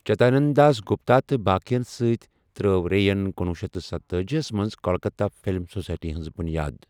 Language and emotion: Kashmiri, neutral